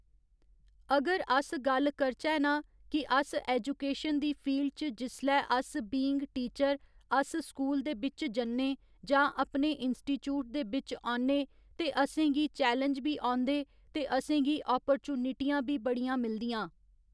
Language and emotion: Dogri, neutral